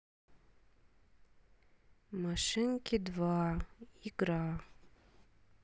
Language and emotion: Russian, sad